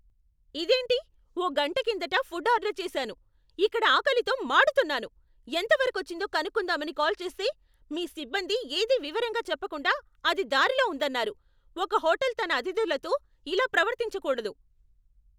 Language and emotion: Telugu, angry